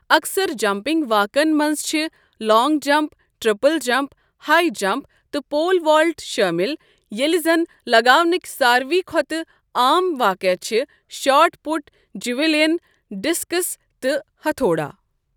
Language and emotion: Kashmiri, neutral